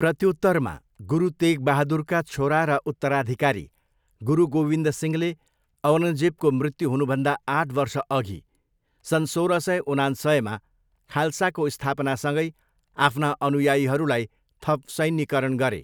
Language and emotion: Nepali, neutral